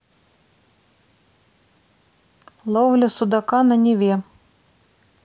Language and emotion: Russian, neutral